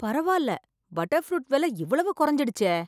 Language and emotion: Tamil, surprised